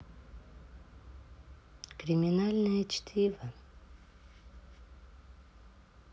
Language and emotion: Russian, neutral